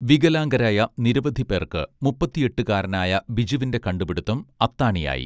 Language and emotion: Malayalam, neutral